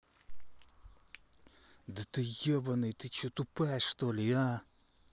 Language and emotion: Russian, angry